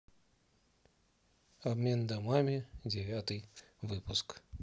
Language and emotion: Russian, neutral